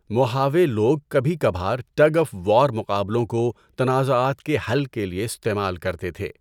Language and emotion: Urdu, neutral